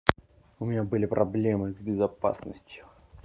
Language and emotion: Russian, angry